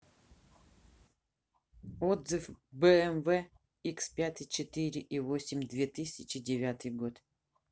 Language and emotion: Russian, neutral